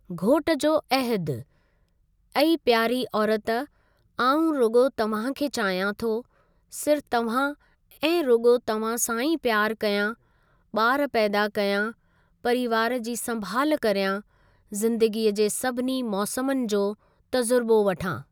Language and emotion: Sindhi, neutral